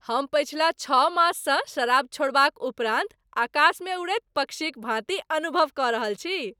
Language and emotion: Maithili, happy